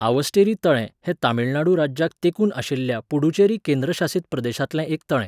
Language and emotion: Goan Konkani, neutral